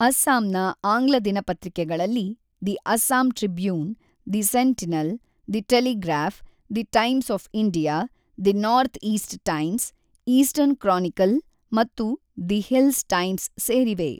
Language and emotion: Kannada, neutral